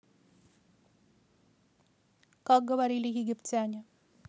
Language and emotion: Russian, neutral